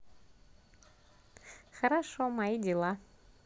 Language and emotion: Russian, positive